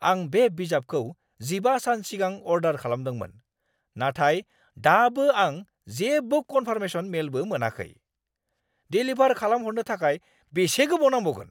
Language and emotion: Bodo, angry